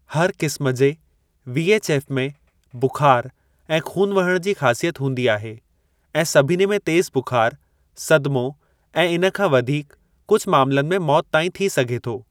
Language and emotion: Sindhi, neutral